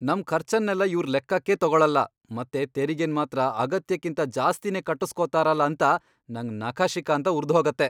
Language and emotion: Kannada, angry